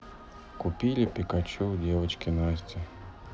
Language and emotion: Russian, sad